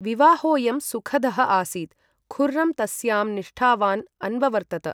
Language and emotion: Sanskrit, neutral